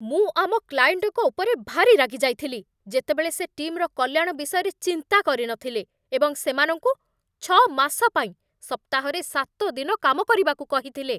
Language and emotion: Odia, angry